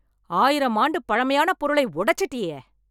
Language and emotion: Tamil, angry